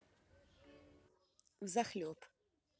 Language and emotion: Russian, neutral